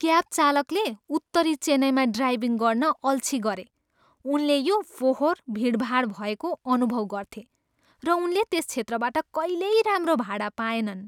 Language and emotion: Nepali, disgusted